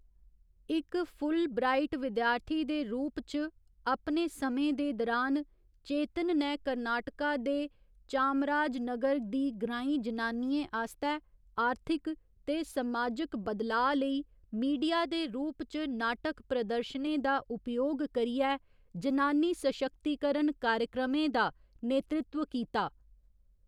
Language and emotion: Dogri, neutral